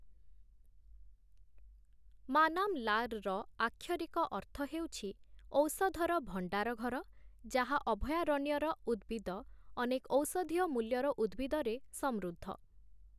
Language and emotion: Odia, neutral